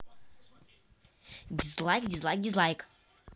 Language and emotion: Russian, neutral